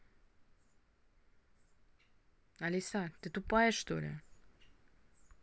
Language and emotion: Russian, angry